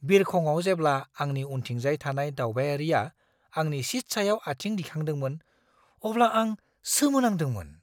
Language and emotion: Bodo, surprised